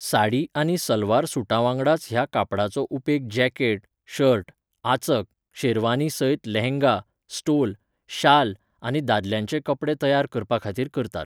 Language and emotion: Goan Konkani, neutral